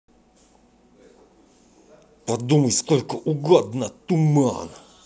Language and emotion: Russian, angry